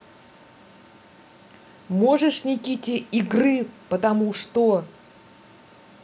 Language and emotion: Russian, angry